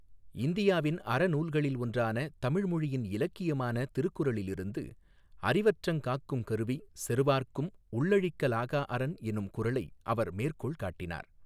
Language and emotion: Tamil, neutral